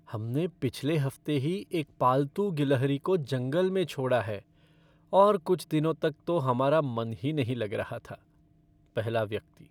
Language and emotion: Hindi, sad